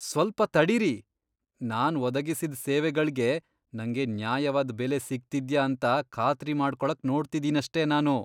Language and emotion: Kannada, disgusted